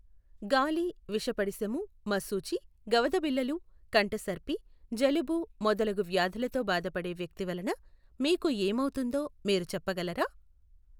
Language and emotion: Telugu, neutral